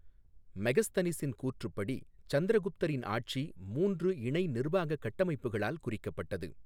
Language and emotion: Tamil, neutral